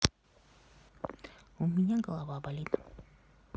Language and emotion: Russian, sad